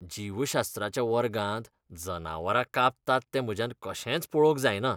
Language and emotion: Goan Konkani, disgusted